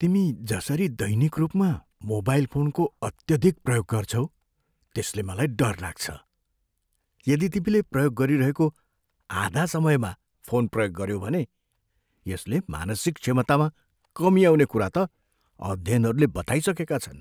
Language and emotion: Nepali, fearful